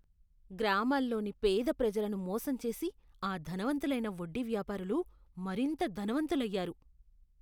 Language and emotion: Telugu, disgusted